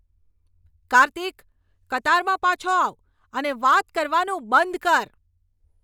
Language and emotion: Gujarati, angry